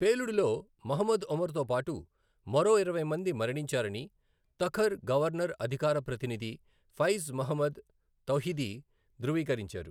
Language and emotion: Telugu, neutral